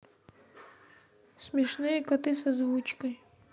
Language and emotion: Russian, neutral